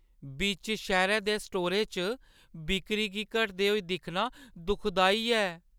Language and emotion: Dogri, sad